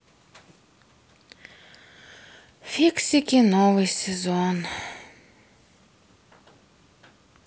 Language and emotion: Russian, sad